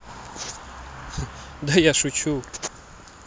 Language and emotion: Russian, positive